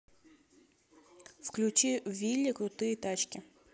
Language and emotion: Russian, neutral